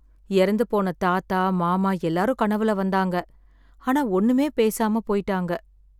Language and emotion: Tamil, sad